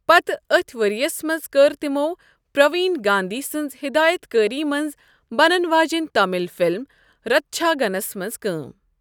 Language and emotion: Kashmiri, neutral